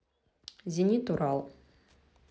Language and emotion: Russian, neutral